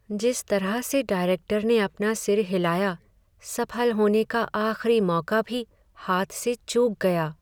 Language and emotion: Hindi, sad